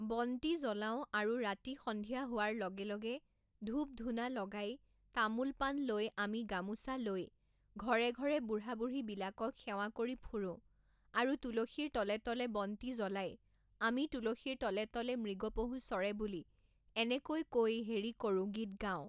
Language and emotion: Assamese, neutral